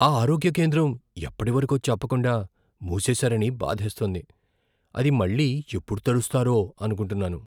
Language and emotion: Telugu, fearful